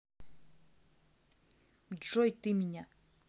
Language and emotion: Russian, neutral